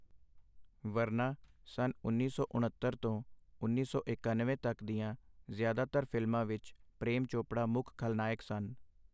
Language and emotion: Punjabi, neutral